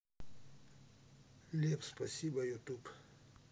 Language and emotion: Russian, neutral